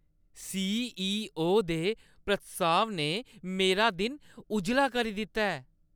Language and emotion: Dogri, happy